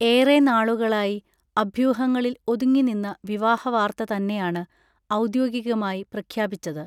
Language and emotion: Malayalam, neutral